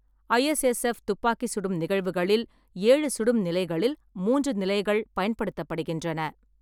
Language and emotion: Tamil, neutral